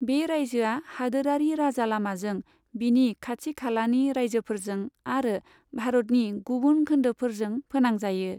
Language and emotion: Bodo, neutral